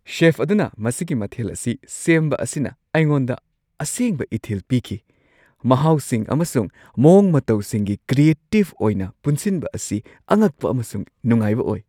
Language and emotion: Manipuri, surprised